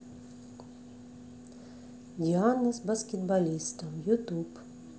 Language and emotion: Russian, neutral